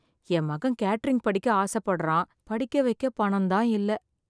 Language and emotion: Tamil, sad